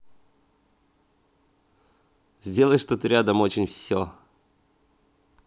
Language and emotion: Russian, positive